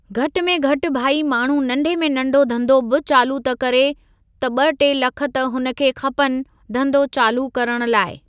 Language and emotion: Sindhi, neutral